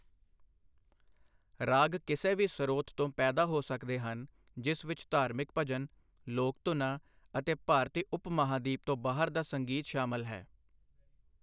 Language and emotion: Punjabi, neutral